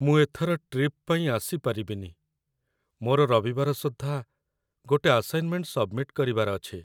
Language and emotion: Odia, sad